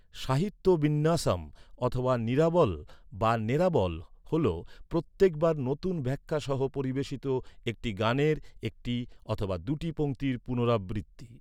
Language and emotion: Bengali, neutral